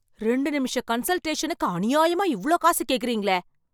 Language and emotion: Tamil, angry